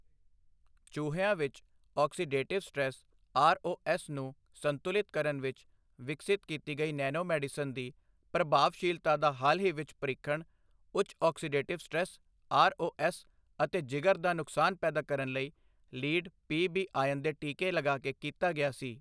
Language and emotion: Punjabi, neutral